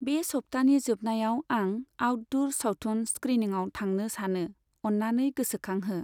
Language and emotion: Bodo, neutral